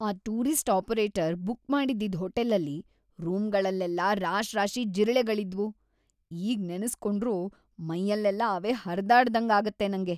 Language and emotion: Kannada, disgusted